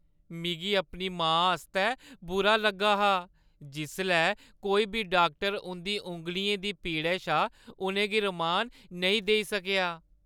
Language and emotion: Dogri, sad